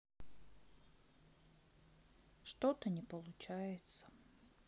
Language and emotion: Russian, sad